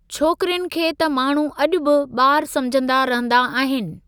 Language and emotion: Sindhi, neutral